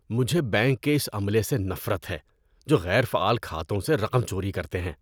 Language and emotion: Urdu, disgusted